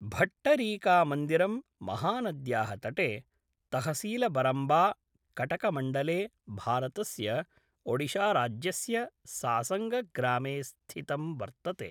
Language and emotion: Sanskrit, neutral